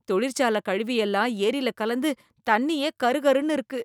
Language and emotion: Tamil, disgusted